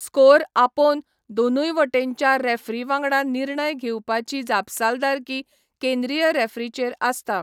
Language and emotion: Goan Konkani, neutral